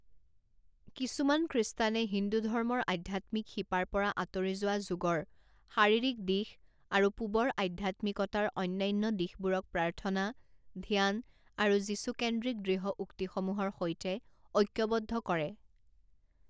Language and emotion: Assamese, neutral